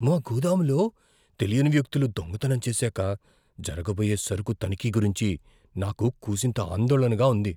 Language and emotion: Telugu, fearful